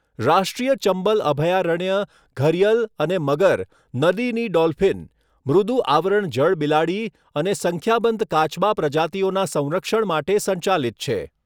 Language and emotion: Gujarati, neutral